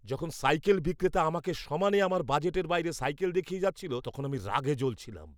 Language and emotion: Bengali, angry